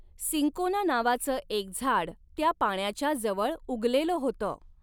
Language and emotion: Marathi, neutral